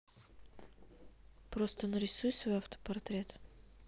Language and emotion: Russian, neutral